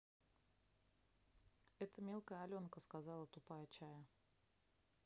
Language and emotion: Russian, neutral